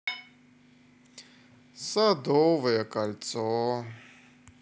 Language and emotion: Russian, sad